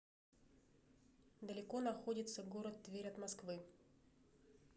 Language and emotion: Russian, neutral